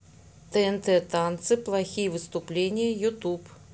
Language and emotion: Russian, neutral